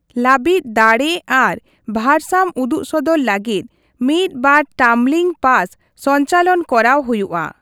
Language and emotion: Santali, neutral